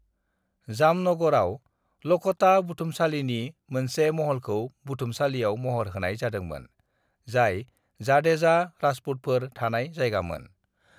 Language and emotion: Bodo, neutral